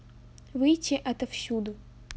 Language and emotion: Russian, neutral